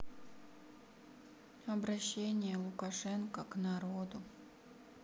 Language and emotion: Russian, sad